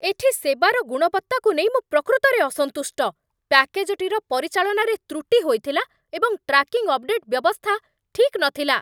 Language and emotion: Odia, angry